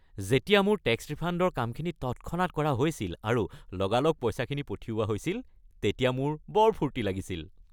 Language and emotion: Assamese, happy